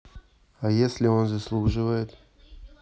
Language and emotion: Russian, neutral